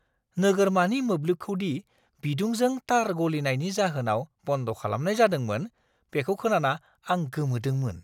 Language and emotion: Bodo, surprised